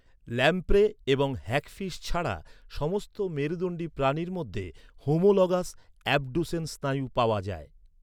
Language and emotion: Bengali, neutral